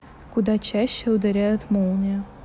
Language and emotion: Russian, neutral